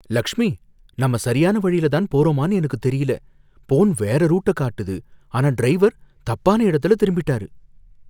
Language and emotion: Tamil, fearful